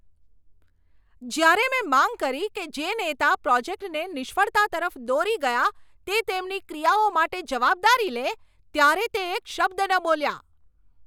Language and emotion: Gujarati, angry